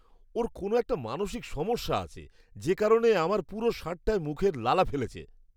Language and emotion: Bengali, disgusted